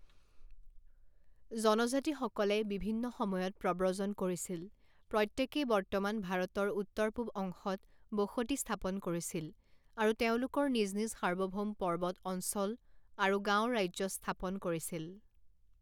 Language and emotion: Assamese, neutral